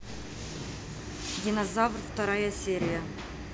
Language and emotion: Russian, neutral